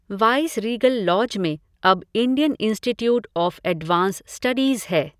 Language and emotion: Hindi, neutral